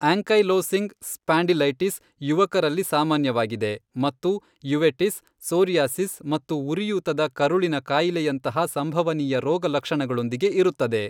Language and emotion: Kannada, neutral